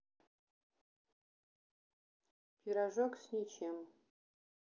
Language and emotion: Russian, neutral